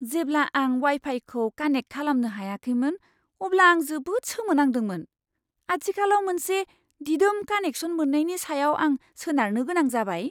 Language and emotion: Bodo, surprised